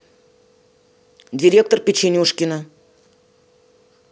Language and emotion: Russian, neutral